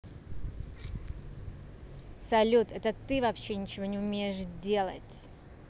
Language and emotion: Russian, angry